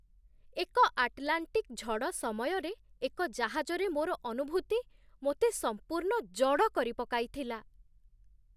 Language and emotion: Odia, surprised